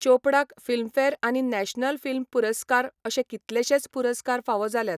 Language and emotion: Goan Konkani, neutral